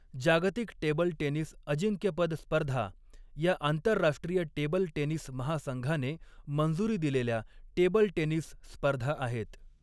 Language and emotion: Marathi, neutral